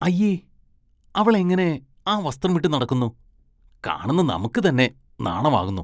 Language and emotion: Malayalam, disgusted